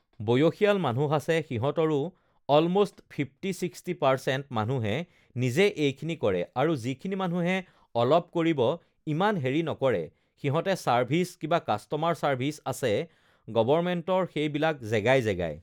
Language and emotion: Assamese, neutral